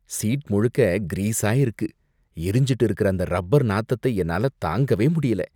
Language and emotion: Tamil, disgusted